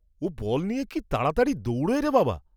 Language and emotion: Bengali, surprised